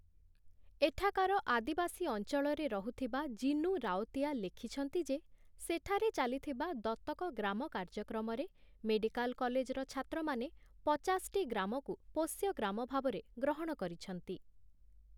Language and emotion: Odia, neutral